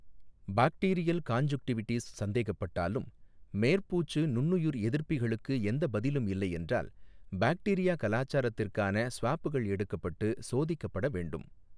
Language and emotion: Tamil, neutral